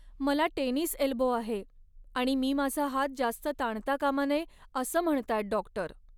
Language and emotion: Marathi, sad